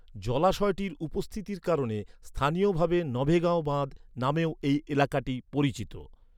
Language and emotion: Bengali, neutral